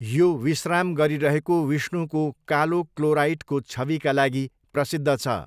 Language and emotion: Nepali, neutral